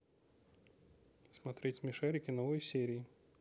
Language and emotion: Russian, neutral